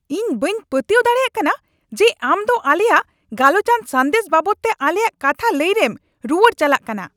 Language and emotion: Santali, angry